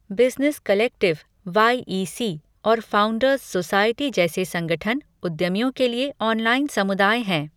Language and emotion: Hindi, neutral